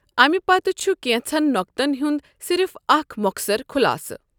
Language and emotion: Kashmiri, neutral